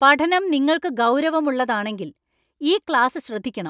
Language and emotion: Malayalam, angry